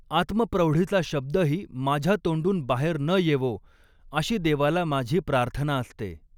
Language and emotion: Marathi, neutral